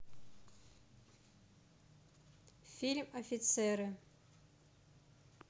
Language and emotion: Russian, neutral